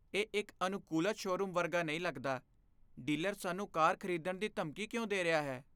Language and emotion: Punjabi, fearful